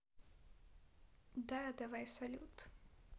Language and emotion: Russian, neutral